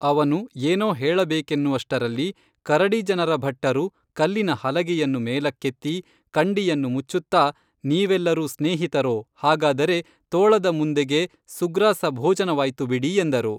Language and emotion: Kannada, neutral